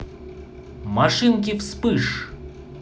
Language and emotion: Russian, positive